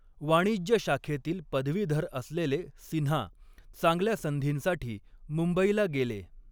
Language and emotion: Marathi, neutral